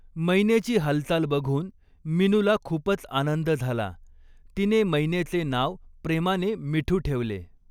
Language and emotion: Marathi, neutral